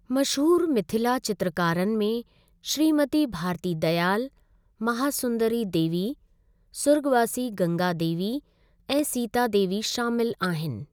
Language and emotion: Sindhi, neutral